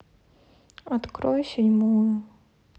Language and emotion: Russian, sad